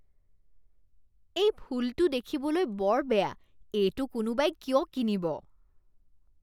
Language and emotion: Assamese, disgusted